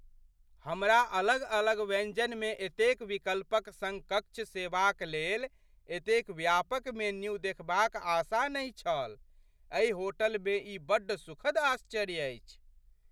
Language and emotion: Maithili, surprised